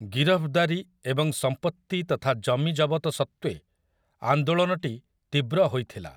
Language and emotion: Odia, neutral